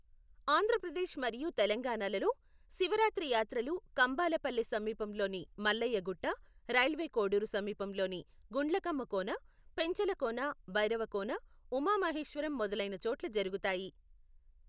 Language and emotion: Telugu, neutral